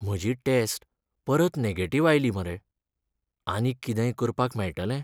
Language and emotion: Goan Konkani, sad